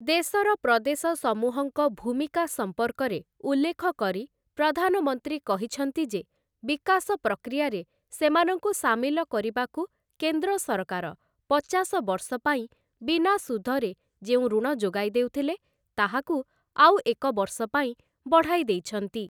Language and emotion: Odia, neutral